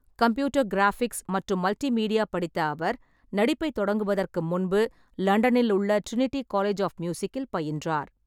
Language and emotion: Tamil, neutral